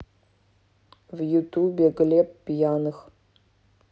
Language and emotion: Russian, neutral